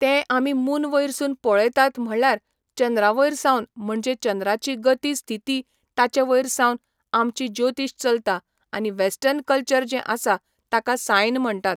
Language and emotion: Goan Konkani, neutral